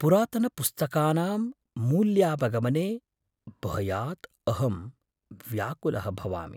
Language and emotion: Sanskrit, fearful